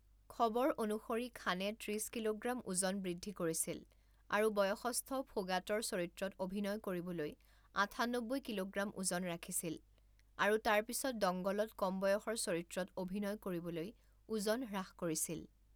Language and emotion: Assamese, neutral